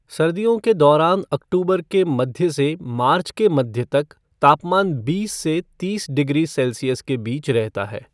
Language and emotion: Hindi, neutral